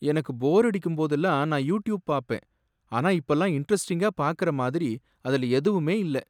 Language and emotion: Tamil, sad